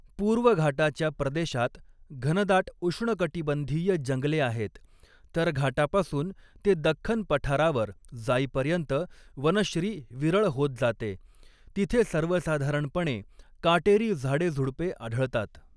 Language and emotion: Marathi, neutral